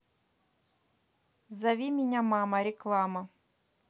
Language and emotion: Russian, neutral